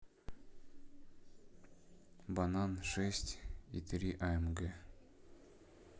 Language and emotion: Russian, neutral